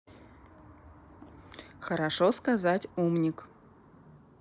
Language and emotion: Russian, neutral